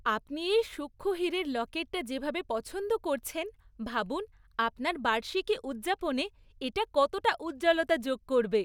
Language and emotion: Bengali, happy